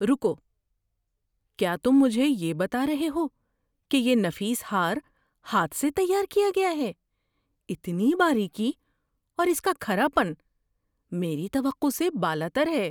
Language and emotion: Urdu, surprised